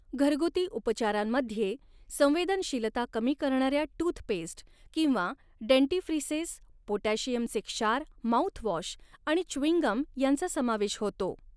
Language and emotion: Marathi, neutral